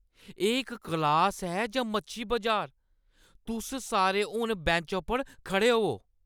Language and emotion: Dogri, angry